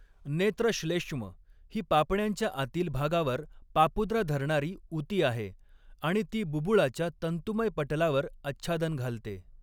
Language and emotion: Marathi, neutral